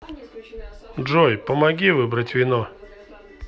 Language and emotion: Russian, neutral